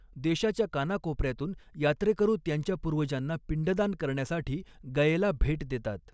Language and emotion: Marathi, neutral